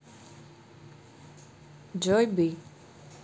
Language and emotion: Russian, neutral